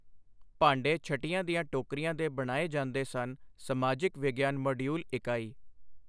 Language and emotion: Punjabi, neutral